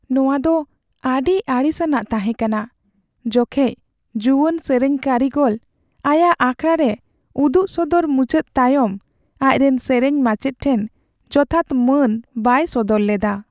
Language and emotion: Santali, sad